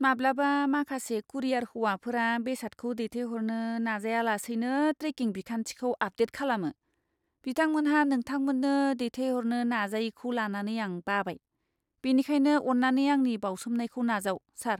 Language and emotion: Bodo, disgusted